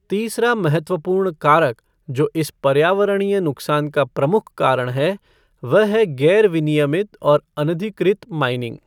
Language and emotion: Hindi, neutral